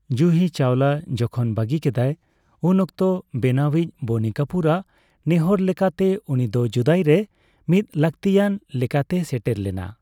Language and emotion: Santali, neutral